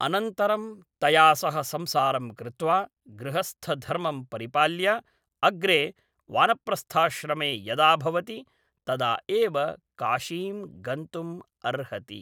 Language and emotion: Sanskrit, neutral